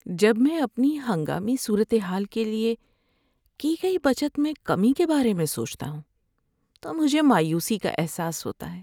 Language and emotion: Urdu, sad